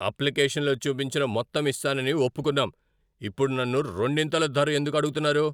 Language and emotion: Telugu, angry